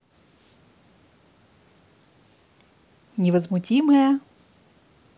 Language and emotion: Russian, neutral